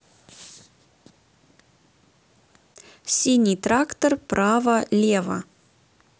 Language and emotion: Russian, neutral